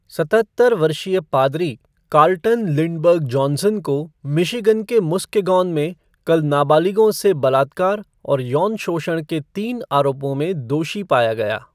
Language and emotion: Hindi, neutral